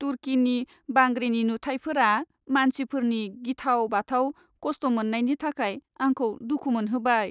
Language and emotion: Bodo, sad